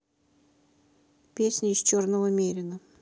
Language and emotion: Russian, neutral